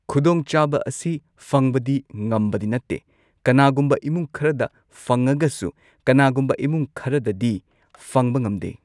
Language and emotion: Manipuri, neutral